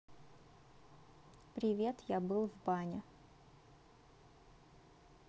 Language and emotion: Russian, neutral